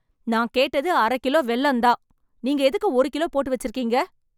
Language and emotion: Tamil, angry